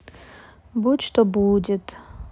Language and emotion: Russian, sad